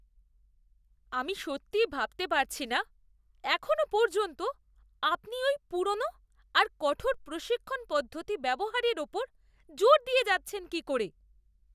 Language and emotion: Bengali, disgusted